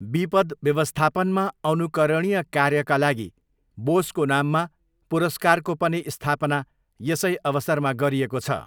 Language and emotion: Nepali, neutral